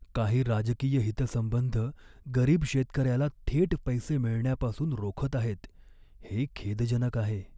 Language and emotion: Marathi, sad